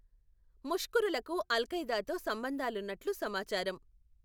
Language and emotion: Telugu, neutral